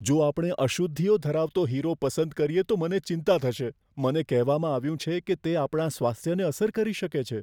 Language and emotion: Gujarati, fearful